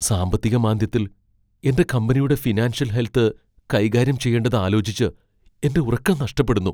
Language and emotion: Malayalam, fearful